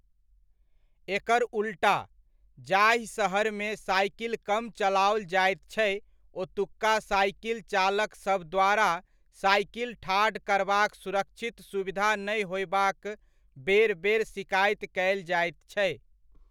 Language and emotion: Maithili, neutral